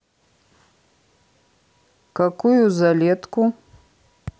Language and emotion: Russian, neutral